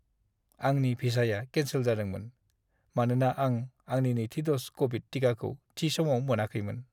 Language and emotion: Bodo, sad